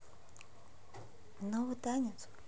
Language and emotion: Russian, neutral